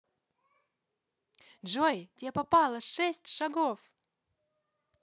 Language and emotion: Russian, positive